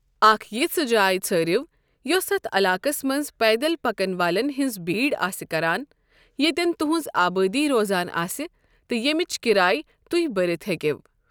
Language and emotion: Kashmiri, neutral